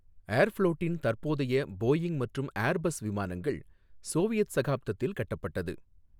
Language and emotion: Tamil, neutral